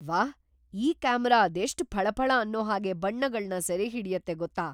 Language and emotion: Kannada, surprised